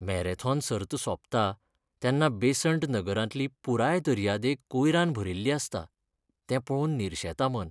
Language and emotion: Goan Konkani, sad